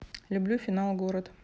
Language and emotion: Russian, neutral